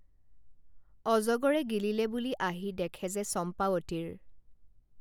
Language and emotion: Assamese, neutral